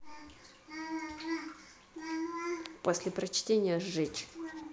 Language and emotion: Russian, angry